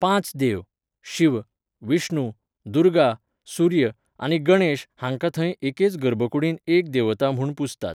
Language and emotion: Goan Konkani, neutral